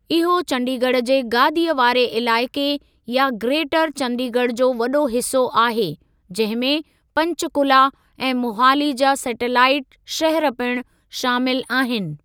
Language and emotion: Sindhi, neutral